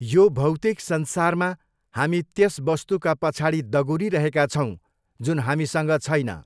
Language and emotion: Nepali, neutral